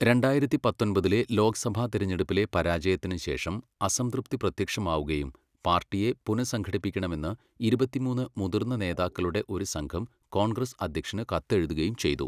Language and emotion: Malayalam, neutral